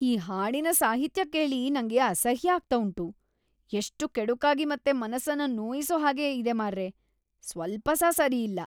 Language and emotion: Kannada, disgusted